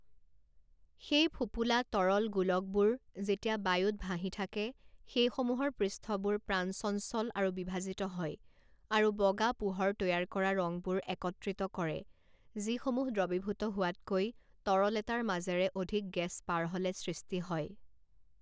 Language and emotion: Assamese, neutral